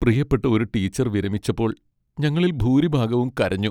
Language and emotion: Malayalam, sad